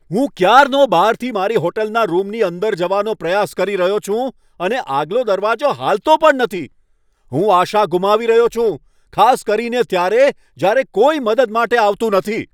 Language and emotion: Gujarati, angry